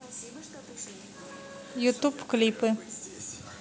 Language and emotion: Russian, neutral